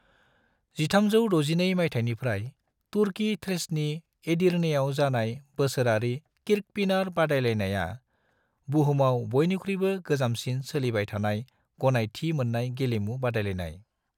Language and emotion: Bodo, neutral